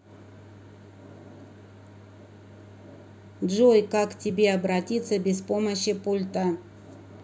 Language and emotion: Russian, neutral